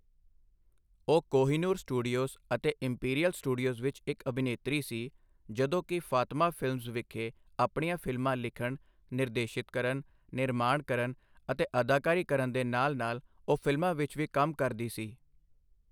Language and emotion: Punjabi, neutral